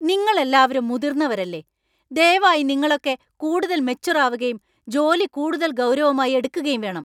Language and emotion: Malayalam, angry